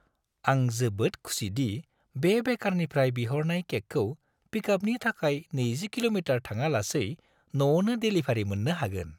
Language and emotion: Bodo, happy